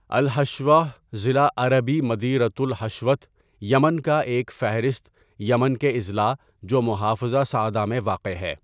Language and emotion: Urdu, neutral